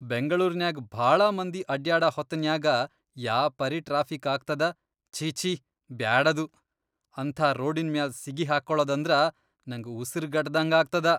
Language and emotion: Kannada, disgusted